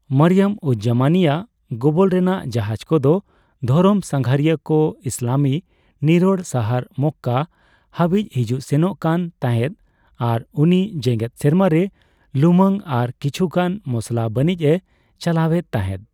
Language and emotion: Santali, neutral